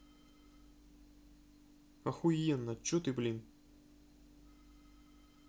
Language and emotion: Russian, angry